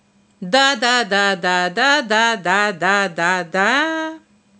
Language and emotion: Russian, positive